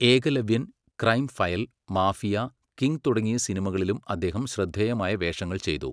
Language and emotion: Malayalam, neutral